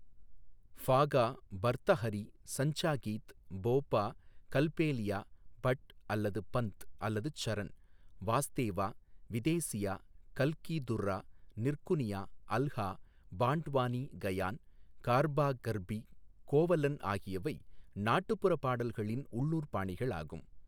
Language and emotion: Tamil, neutral